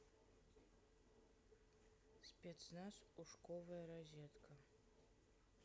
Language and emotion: Russian, neutral